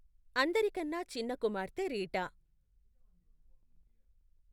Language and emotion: Telugu, neutral